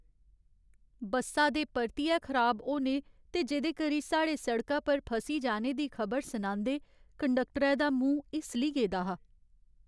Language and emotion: Dogri, sad